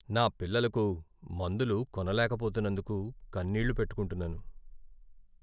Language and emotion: Telugu, sad